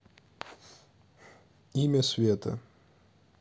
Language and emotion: Russian, neutral